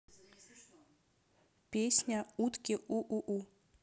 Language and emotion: Russian, neutral